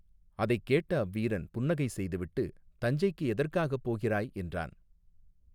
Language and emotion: Tamil, neutral